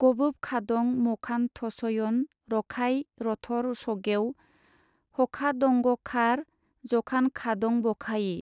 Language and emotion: Bodo, neutral